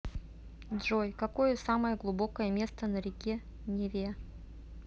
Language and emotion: Russian, neutral